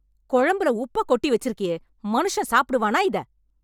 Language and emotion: Tamil, angry